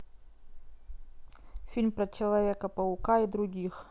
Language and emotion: Russian, neutral